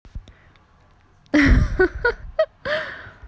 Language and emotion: Russian, positive